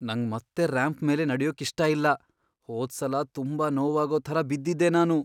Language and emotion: Kannada, fearful